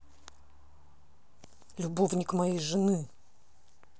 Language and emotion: Russian, angry